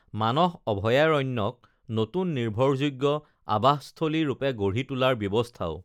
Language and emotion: Assamese, neutral